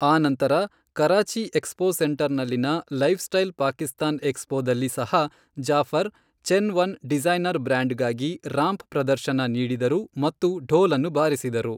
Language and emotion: Kannada, neutral